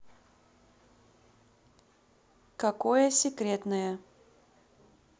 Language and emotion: Russian, neutral